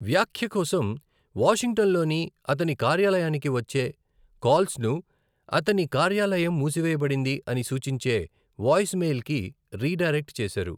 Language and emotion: Telugu, neutral